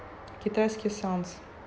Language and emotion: Russian, neutral